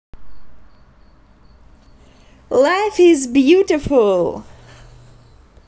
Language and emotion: Russian, positive